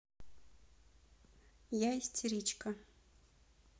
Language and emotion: Russian, neutral